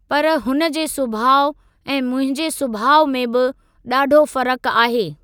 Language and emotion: Sindhi, neutral